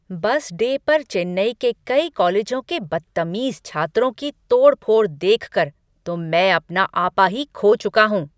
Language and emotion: Hindi, angry